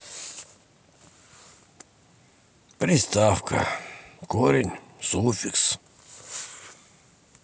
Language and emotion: Russian, sad